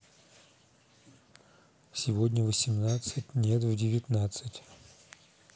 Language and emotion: Russian, neutral